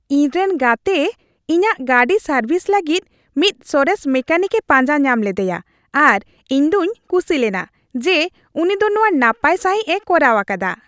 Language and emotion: Santali, happy